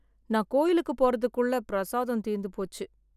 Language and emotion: Tamil, sad